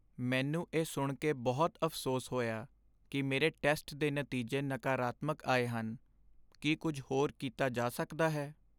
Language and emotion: Punjabi, sad